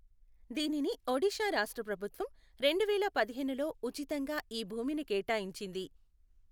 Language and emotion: Telugu, neutral